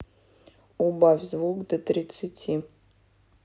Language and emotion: Russian, neutral